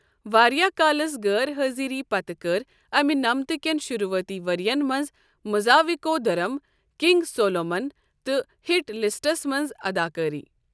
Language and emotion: Kashmiri, neutral